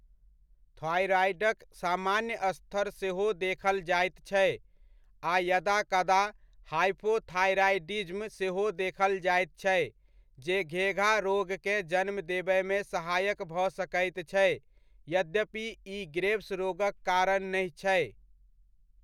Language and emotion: Maithili, neutral